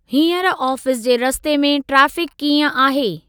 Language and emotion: Sindhi, neutral